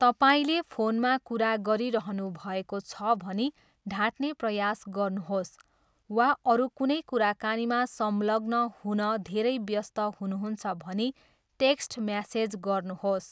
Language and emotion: Nepali, neutral